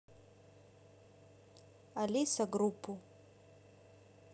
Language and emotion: Russian, neutral